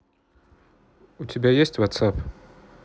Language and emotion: Russian, neutral